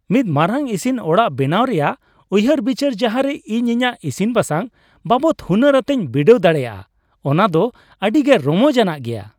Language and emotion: Santali, happy